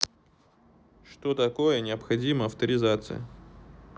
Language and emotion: Russian, neutral